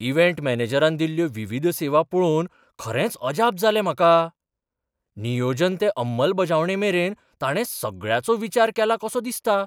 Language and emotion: Goan Konkani, surprised